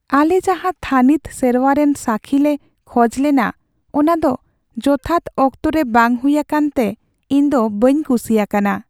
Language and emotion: Santali, sad